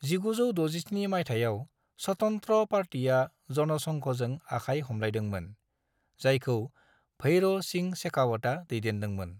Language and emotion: Bodo, neutral